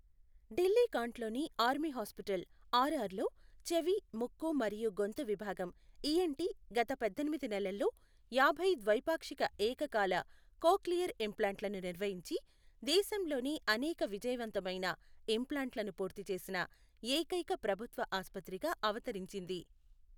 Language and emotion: Telugu, neutral